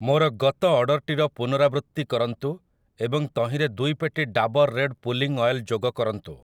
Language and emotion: Odia, neutral